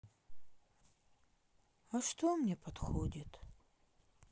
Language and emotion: Russian, sad